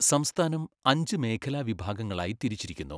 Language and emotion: Malayalam, neutral